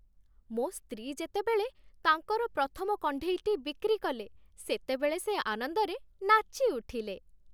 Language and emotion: Odia, happy